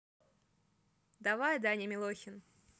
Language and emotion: Russian, neutral